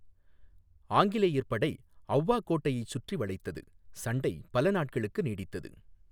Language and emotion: Tamil, neutral